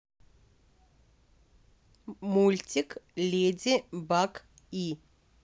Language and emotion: Russian, neutral